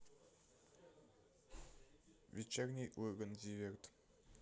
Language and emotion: Russian, neutral